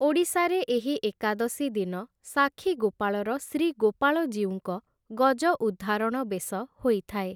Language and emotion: Odia, neutral